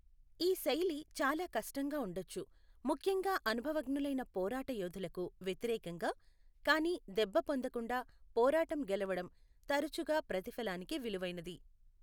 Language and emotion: Telugu, neutral